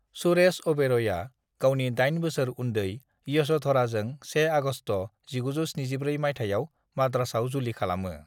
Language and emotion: Bodo, neutral